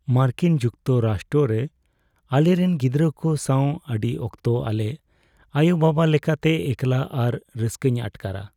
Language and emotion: Santali, sad